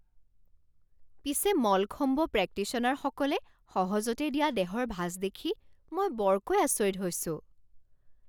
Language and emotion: Assamese, surprised